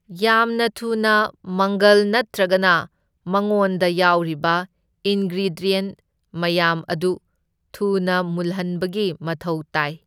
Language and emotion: Manipuri, neutral